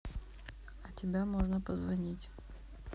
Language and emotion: Russian, sad